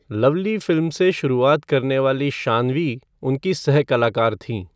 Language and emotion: Hindi, neutral